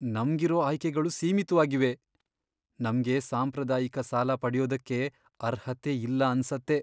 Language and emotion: Kannada, sad